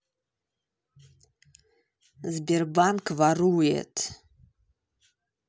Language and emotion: Russian, angry